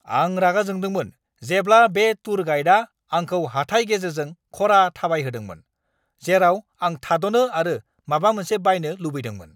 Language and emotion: Bodo, angry